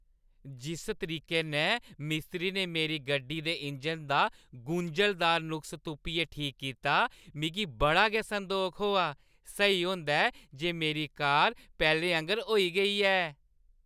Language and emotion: Dogri, happy